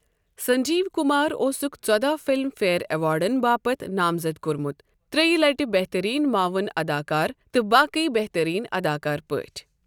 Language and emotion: Kashmiri, neutral